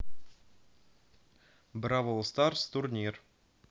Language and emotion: Russian, neutral